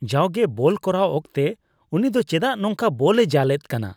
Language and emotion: Santali, disgusted